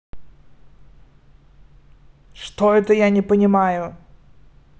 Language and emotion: Russian, angry